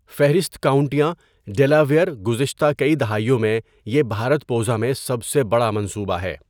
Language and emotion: Urdu, neutral